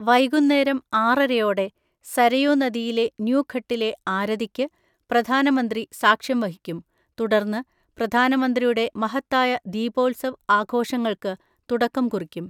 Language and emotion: Malayalam, neutral